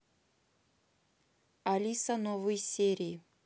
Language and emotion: Russian, neutral